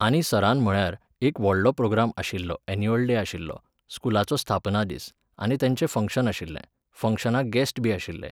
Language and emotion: Goan Konkani, neutral